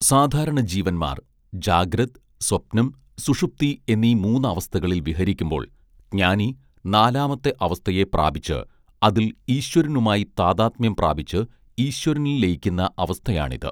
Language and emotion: Malayalam, neutral